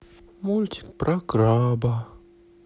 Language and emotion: Russian, sad